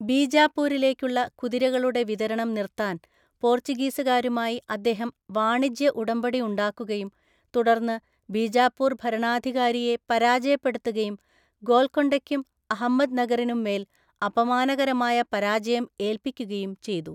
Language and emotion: Malayalam, neutral